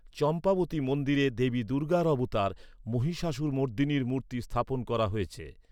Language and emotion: Bengali, neutral